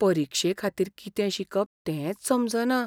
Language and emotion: Goan Konkani, fearful